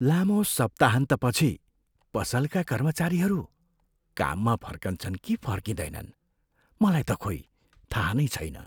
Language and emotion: Nepali, fearful